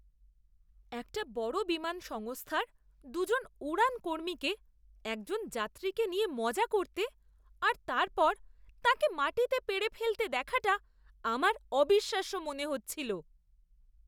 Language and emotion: Bengali, disgusted